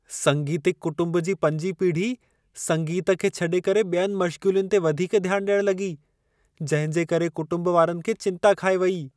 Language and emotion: Sindhi, fearful